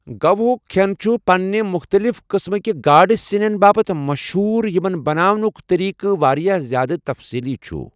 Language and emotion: Kashmiri, neutral